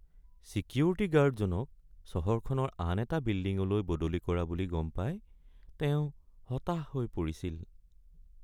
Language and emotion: Assamese, sad